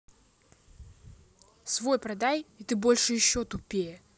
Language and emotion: Russian, angry